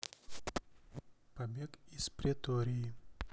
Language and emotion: Russian, neutral